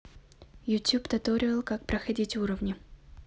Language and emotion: Russian, neutral